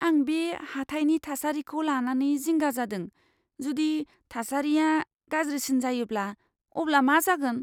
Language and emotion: Bodo, fearful